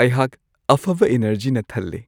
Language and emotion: Manipuri, happy